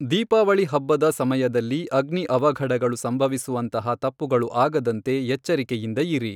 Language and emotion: Kannada, neutral